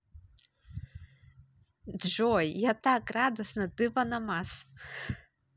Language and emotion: Russian, positive